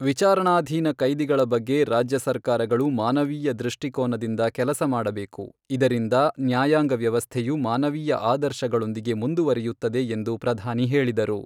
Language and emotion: Kannada, neutral